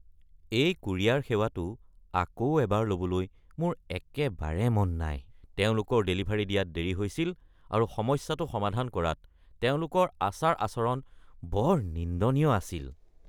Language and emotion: Assamese, disgusted